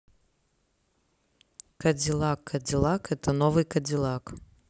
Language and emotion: Russian, neutral